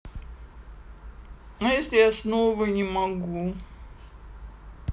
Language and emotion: Russian, sad